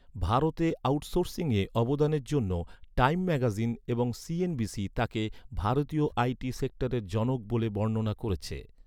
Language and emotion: Bengali, neutral